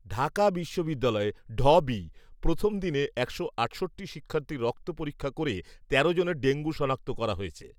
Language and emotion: Bengali, neutral